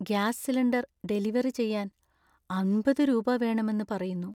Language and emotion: Malayalam, sad